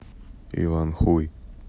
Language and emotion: Russian, neutral